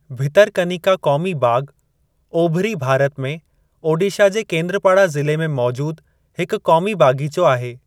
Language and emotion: Sindhi, neutral